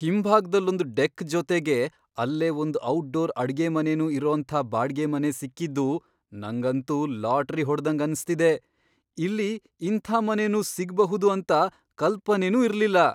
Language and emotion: Kannada, surprised